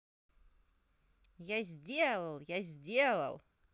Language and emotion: Russian, positive